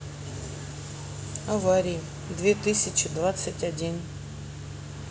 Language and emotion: Russian, sad